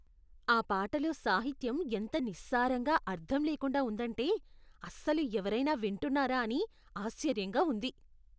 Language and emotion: Telugu, disgusted